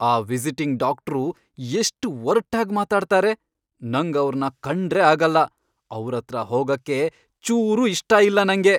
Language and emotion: Kannada, angry